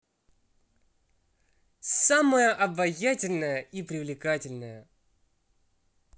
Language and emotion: Russian, positive